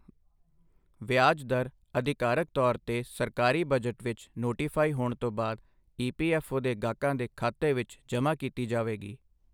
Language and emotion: Punjabi, neutral